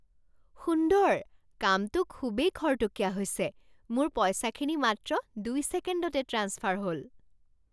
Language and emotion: Assamese, surprised